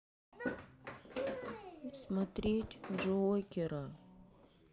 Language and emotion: Russian, sad